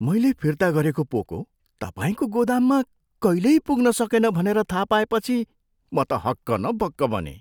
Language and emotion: Nepali, surprised